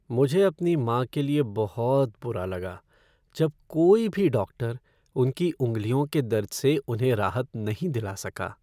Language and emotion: Hindi, sad